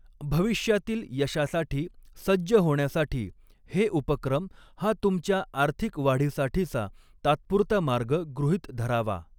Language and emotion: Marathi, neutral